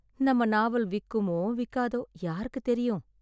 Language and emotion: Tamil, sad